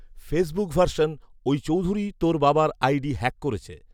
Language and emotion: Bengali, neutral